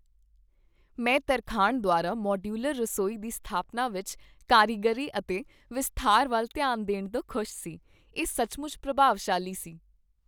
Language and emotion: Punjabi, happy